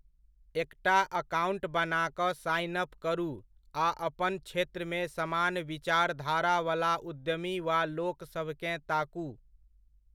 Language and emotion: Maithili, neutral